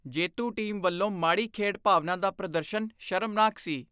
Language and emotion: Punjabi, disgusted